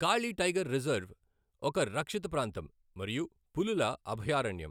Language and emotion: Telugu, neutral